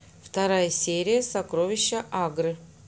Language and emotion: Russian, neutral